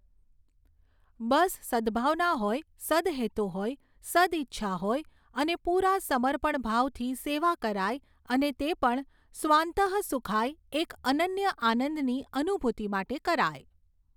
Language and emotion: Gujarati, neutral